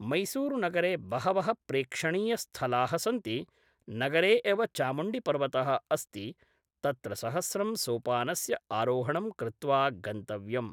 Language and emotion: Sanskrit, neutral